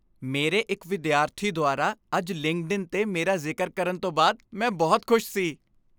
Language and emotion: Punjabi, happy